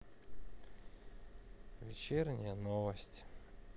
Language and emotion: Russian, sad